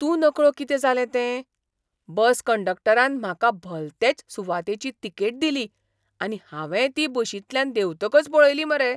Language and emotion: Goan Konkani, surprised